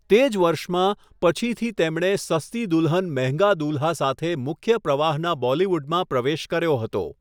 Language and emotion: Gujarati, neutral